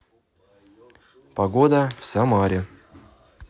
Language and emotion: Russian, neutral